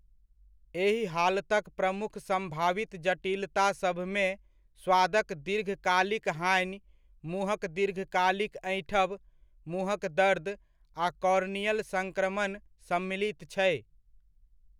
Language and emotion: Maithili, neutral